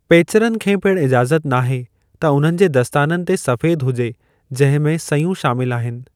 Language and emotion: Sindhi, neutral